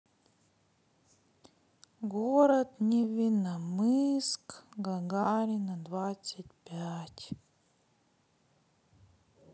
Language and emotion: Russian, sad